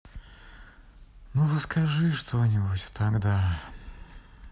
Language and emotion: Russian, sad